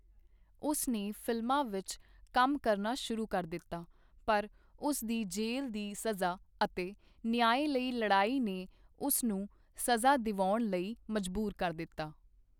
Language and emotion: Punjabi, neutral